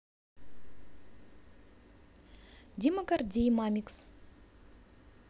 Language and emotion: Russian, neutral